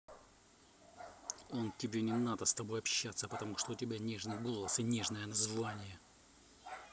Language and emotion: Russian, angry